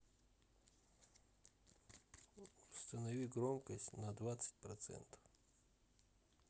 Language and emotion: Russian, neutral